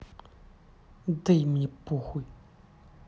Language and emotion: Russian, angry